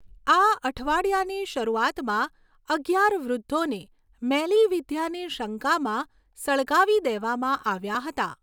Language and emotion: Gujarati, neutral